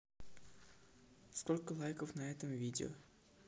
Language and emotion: Russian, neutral